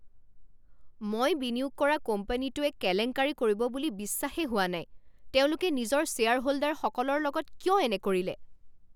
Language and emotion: Assamese, angry